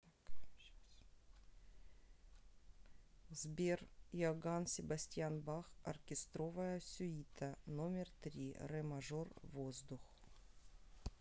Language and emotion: Russian, neutral